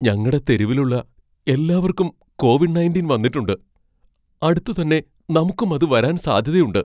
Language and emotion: Malayalam, fearful